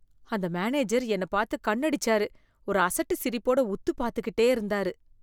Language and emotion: Tamil, disgusted